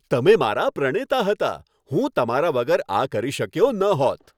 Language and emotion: Gujarati, happy